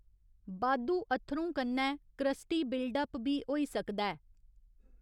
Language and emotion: Dogri, neutral